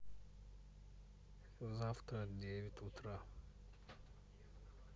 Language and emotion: Russian, neutral